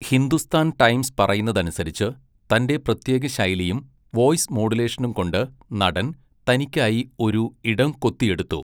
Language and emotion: Malayalam, neutral